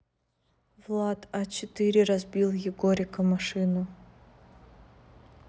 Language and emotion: Russian, neutral